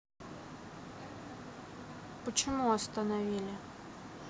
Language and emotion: Russian, sad